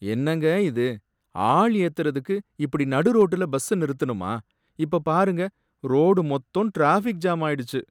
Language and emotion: Tamil, sad